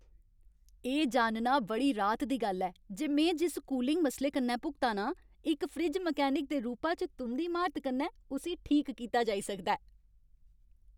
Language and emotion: Dogri, happy